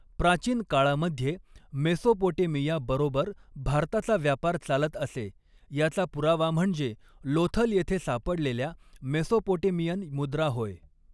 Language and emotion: Marathi, neutral